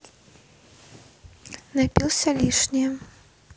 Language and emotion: Russian, neutral